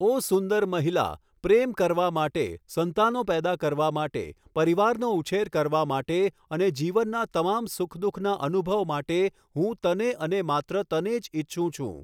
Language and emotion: Gujarati, neutral